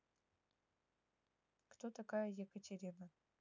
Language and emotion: Russian, neutral